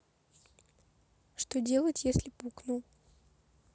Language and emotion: Russian, neutral